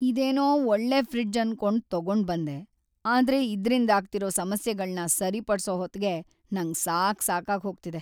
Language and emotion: Kannada, sad